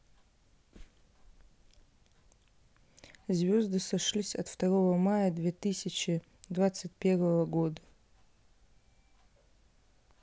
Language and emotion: Russian, neutral